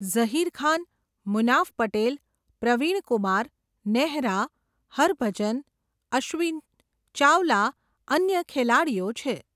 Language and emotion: Gujarati, neutral